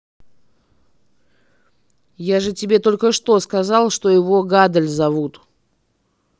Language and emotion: Russian, angry